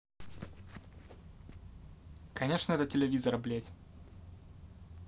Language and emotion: Russian, angry